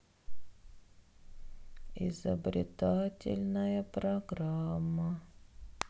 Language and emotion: Russian, sad